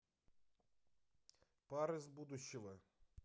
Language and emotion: Russian, neutral